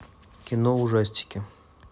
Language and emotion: Russian, neutral